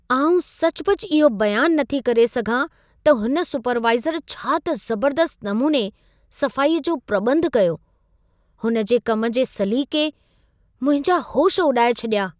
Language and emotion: Sindhi, surprised